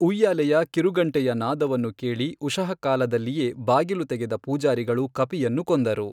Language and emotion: Kannada, neutral